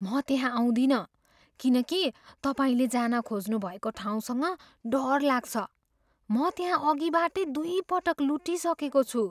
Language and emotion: Nepali, fearful